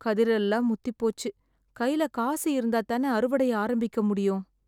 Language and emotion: Tamil, sad